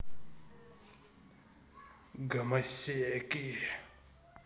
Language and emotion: Russian, angry